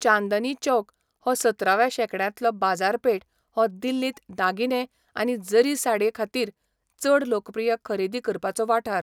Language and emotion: Goan Konkani, neutral